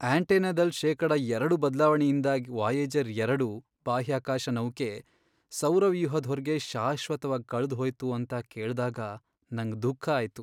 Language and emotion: Kannada, sad